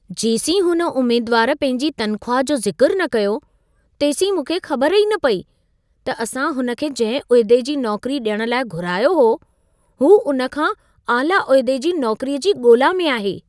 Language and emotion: Sindhi, surprised